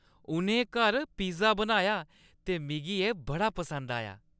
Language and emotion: Dogri, happy